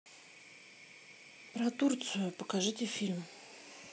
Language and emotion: Russian, neutral